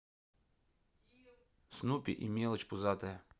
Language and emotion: Russian, neutral